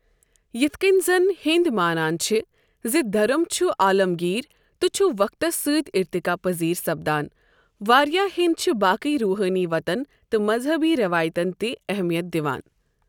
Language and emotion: Kashmiri, neutral